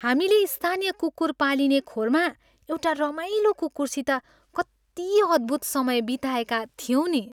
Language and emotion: Nepali, happy